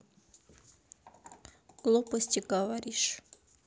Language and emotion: Russian, neutral